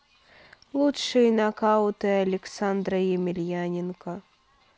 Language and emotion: Russian, sad